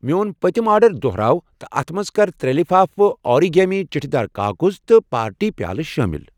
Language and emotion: Kashmiri, neutral